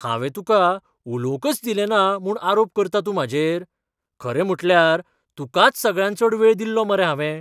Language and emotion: Goan Konkani, surprised